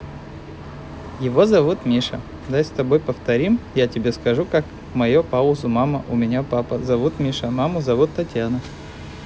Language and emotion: Russian, positive